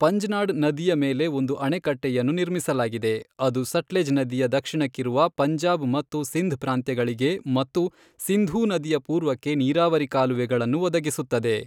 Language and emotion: Kannada, neutral